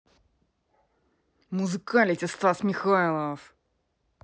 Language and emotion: Russian, angry